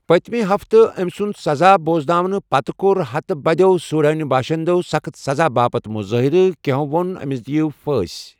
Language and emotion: Kashmiri, neutral